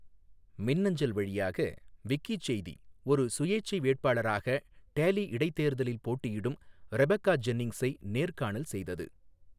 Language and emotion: Tamil, neutral